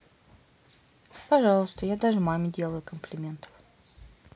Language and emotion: Russian, neutral